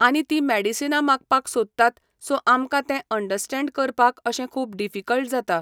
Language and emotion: Goan Konkani, neutral